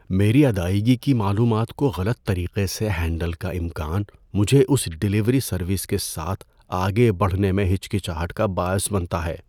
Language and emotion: Urdu, fearful